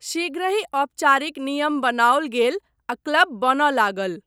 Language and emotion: Maithili, neutral